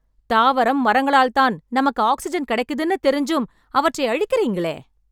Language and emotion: Tamil, angry